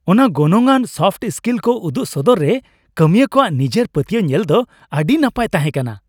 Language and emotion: Santali, happy